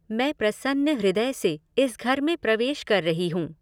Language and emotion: Hindi, neutral